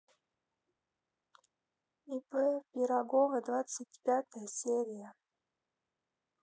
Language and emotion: Russian, neutral